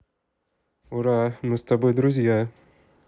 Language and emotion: Russian, positive